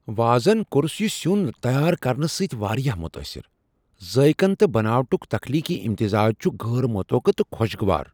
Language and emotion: Kashmiri, surprised